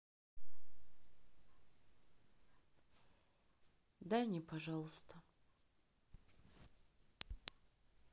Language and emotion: Russian, sad